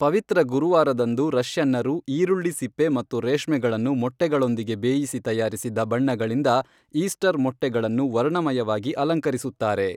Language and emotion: Kannada, neutral